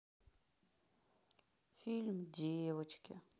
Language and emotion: Russian, sad